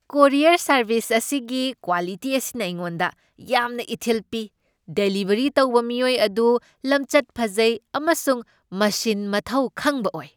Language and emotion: Manipuri, happy